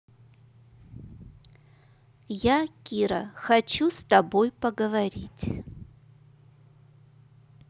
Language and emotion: Russian, neutral